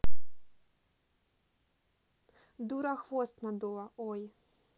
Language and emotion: Russian, neutral